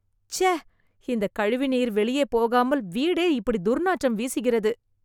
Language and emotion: Tamil, disgusted